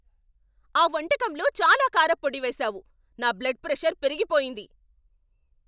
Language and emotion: Telugu, angry